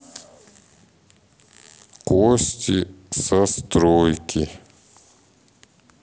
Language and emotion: Russian, neutral